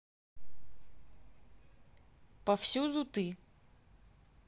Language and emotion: Russian, neutral